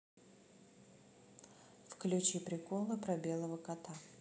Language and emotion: Russian, neutral